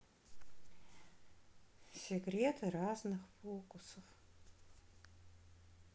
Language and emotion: Russian, neutral